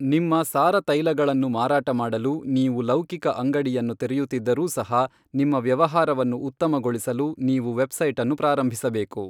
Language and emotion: Kannada, neutral